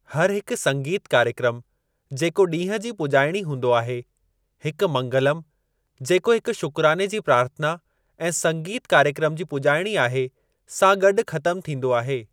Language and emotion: Sindhi, neutral